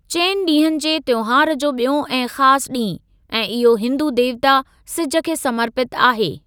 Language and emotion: Sindhi, neutral